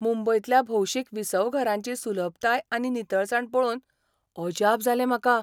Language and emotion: Goan Konkani, surprised